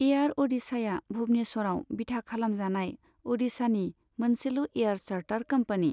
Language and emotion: Bodo, neutral